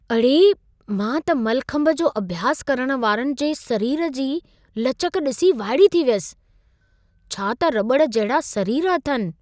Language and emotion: Sindhi, surprised